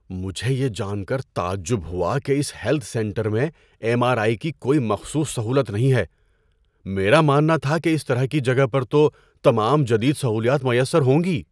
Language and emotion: Urdu, surprised